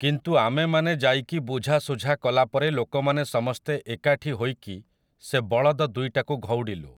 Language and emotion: Odia, neutral